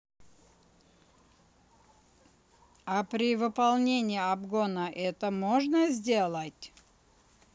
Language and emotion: Russian, neutral